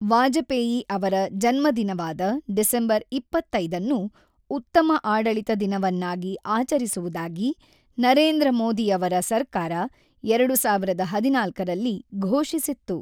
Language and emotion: Kannada, neutral